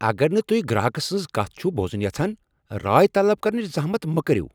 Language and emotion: Kashmiri, angry